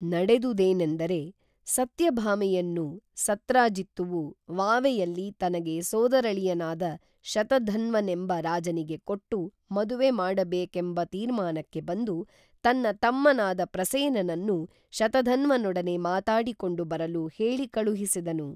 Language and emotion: Kannada, neutral